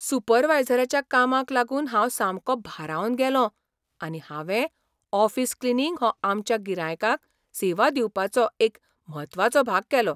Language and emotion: Goan Konkani, surprised